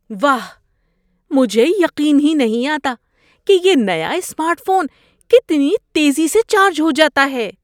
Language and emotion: Urdu, surprised